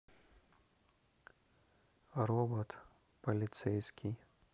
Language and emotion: Russian, neutral